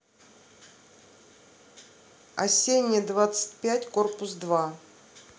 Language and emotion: Russian, neutral